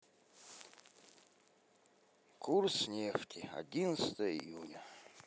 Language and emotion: Russian, sad